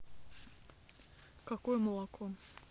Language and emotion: Russian, neutral